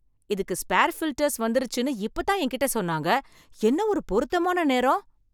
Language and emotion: Tamil, surprised